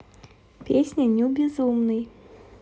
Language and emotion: Russian, neutral